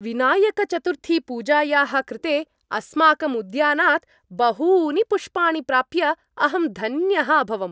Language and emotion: Sanskrit, happy